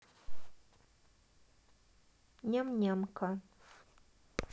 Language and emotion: Russian, neutral